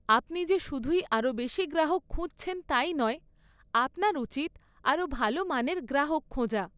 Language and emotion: Bengali, neutral